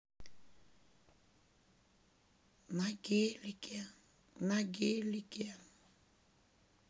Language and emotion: Russian, sad